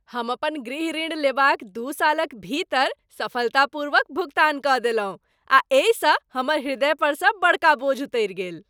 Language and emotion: Maithili, happy